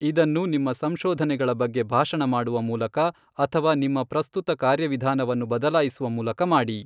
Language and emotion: Kannada, neutral